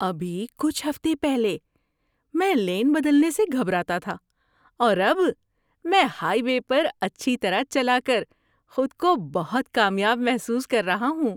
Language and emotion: Urdu, happy